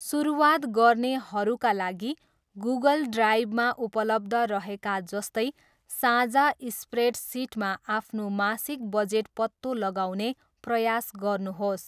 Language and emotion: Nepali, neutral